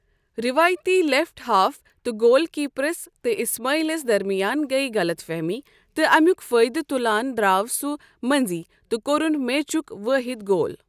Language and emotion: Kashmiri, neutral